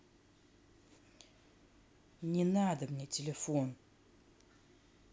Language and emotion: Russian, angry